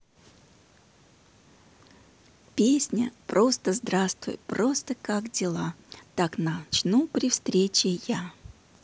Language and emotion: Russian, positive